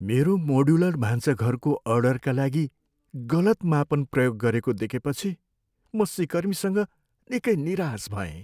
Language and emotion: Nepali, sad